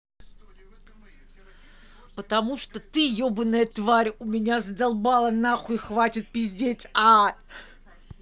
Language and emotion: Russian, angry